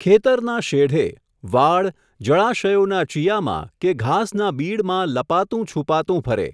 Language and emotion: Gujarati, neutral